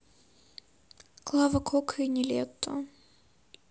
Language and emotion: Russian, sad